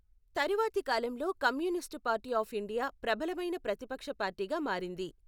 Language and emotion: Telugu, neutral